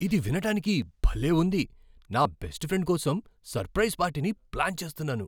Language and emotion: Telugu, surprised